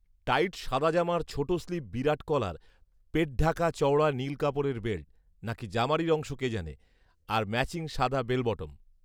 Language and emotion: Bengali, neutral